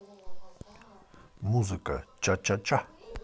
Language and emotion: Russian, positive